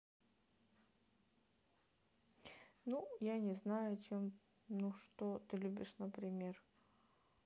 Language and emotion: Russian, neutral